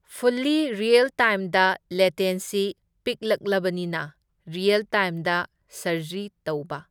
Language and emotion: Manipuri, neutral